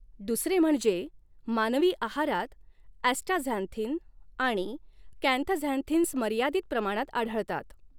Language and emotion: Marathi, neutral